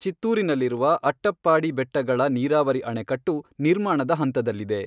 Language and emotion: Kannada, neutral